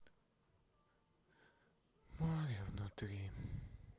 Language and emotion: Russian, sad